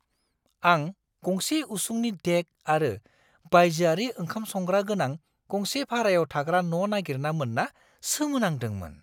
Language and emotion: Bodo, surprised